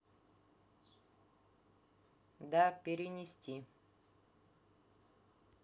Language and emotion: Russian, neutral